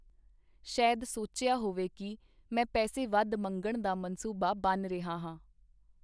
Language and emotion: Punjabi, neutral